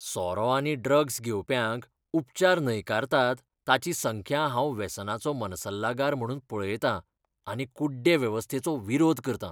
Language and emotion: Goan Konkani, disgusted